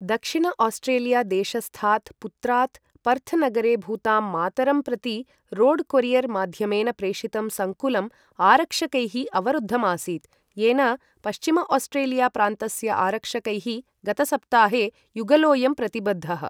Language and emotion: Sanskrit, neutral